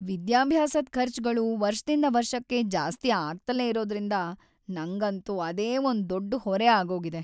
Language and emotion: Kannada, sad